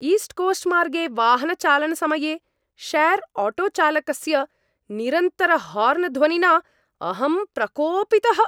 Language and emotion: Sanskrit, angry